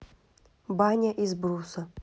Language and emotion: Russian, neutral